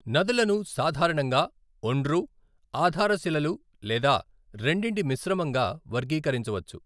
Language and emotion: Telugu, neutral